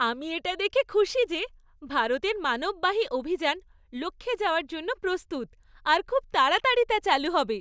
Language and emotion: Bengali, happy